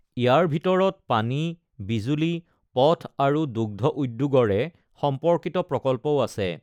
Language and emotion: Assamese, neutral